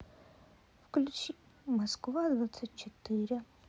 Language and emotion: Russian, sad